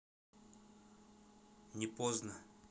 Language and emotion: Russian, neutral